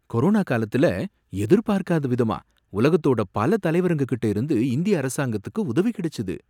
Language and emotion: Tamil, surprised